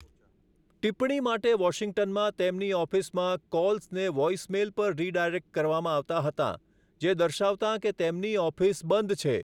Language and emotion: Gujarati, neutral